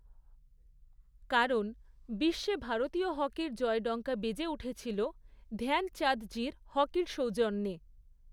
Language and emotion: Bengali, neutral